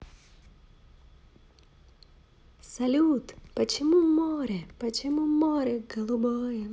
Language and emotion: Russian, positive